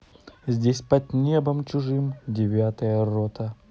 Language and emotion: Russian, positive